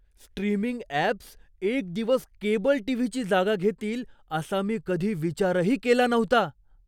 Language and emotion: Marathi, surprised